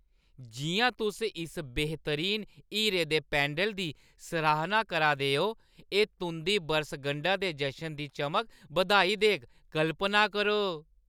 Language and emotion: Dogri, happy